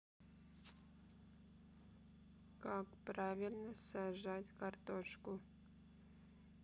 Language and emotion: Russian, neutral